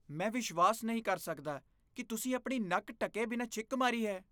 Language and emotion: Punjabi, disgusted